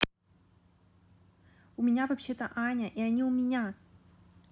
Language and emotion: Russian, angry